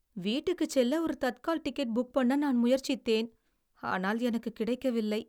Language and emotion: Tamil, sad